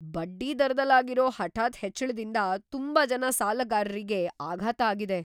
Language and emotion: Kannada, surprised